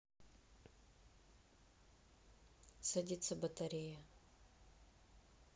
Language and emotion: Russian, sad